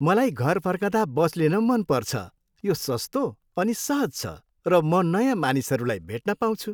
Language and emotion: Nepali, happy